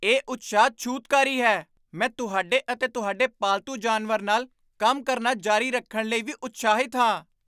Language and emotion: Punjabi, surprised